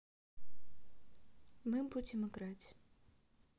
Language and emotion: Russian, neutral